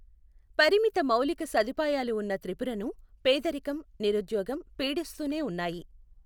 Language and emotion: Telugu, neutral